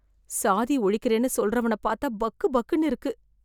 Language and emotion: Tamil, fearful